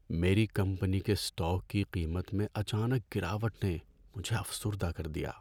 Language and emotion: Urdu, sad